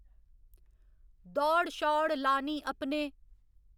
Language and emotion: Dogri, neutral